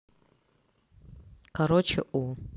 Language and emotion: Russian, neutral